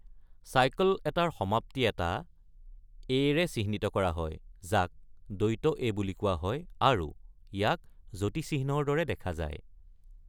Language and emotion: Assamese, neutral